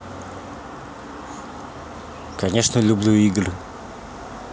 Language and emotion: Russian, neutral